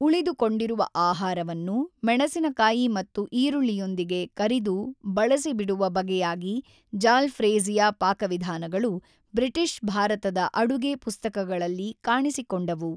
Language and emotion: Kannada, neutral